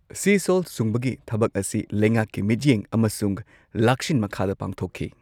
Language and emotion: Manipuri, neutral